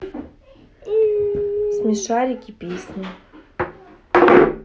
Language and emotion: Russian, neutral